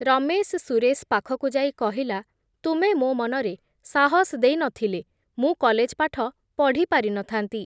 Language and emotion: Odia, neutral